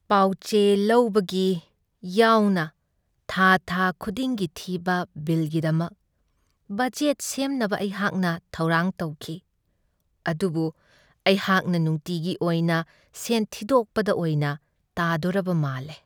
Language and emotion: Manipuri, sad